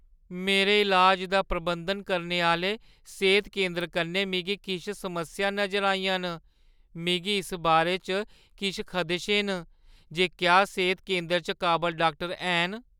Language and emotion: Dogri, fearful